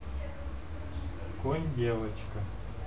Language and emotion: Russian, neutral